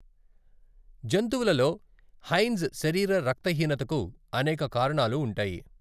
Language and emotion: Telugu, neutral